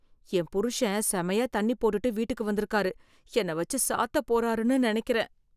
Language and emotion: Tamil, fearful